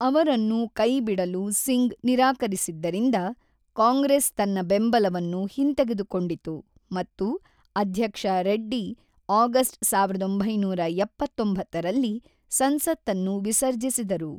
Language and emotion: Kannada, neutral